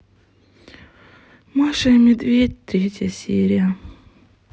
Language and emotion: Russian, sad